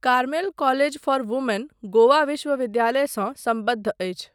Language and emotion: Maithili, neutral